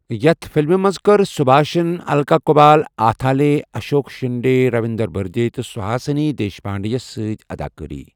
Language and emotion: Kashmiri, neutral